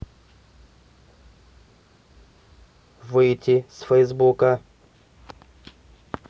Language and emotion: Russian, neutral